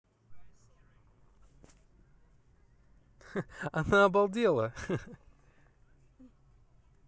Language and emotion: Russian, positive